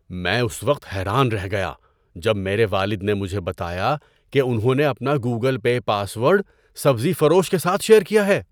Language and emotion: Urdu, surprised